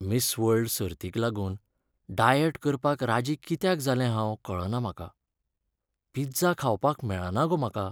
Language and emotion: Goan Konkani, sad